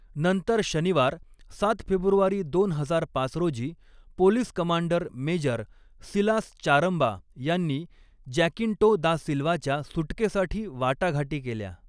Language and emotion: Marathi, neutral